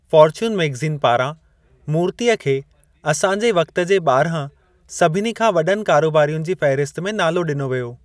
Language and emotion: Sindhi, neutral